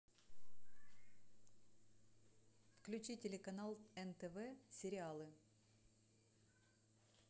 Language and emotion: Russian, neutral